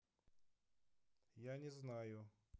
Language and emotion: Russian, neutral